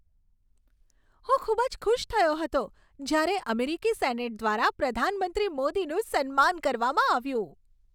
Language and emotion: Gujarati, happy